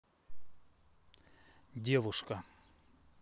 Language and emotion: Russian, neutral